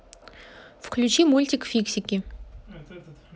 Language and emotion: Russian, neutral